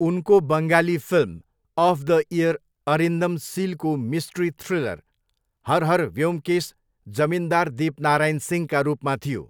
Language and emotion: Nepali, neutral